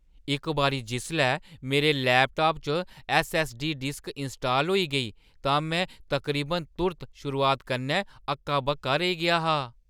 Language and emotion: Dogri, surprised